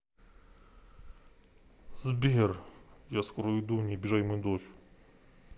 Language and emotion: Russian, neutral